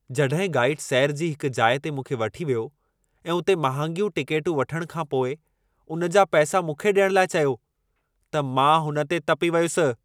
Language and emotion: Sindhi, angry